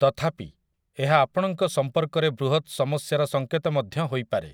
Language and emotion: Odia, neutral